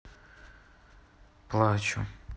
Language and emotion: Russian, sad